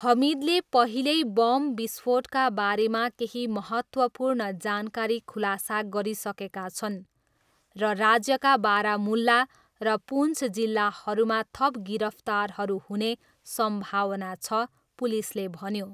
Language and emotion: Nepali, neutral